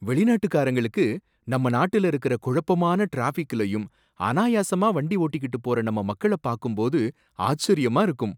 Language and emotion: Tamil, surprised